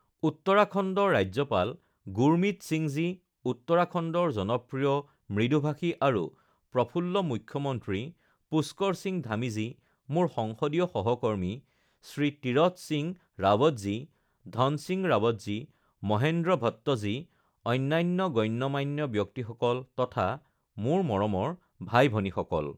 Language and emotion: Assamese, neutral